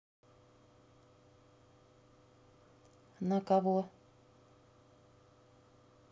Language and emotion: Russian, neutral